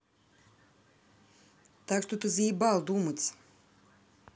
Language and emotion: Russian, angry